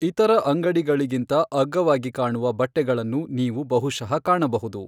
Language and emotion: Kannada, neutral